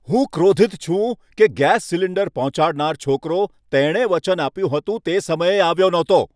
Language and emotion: Gujarati, angry